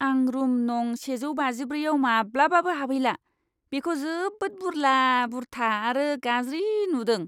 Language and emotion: Bodo, disgusted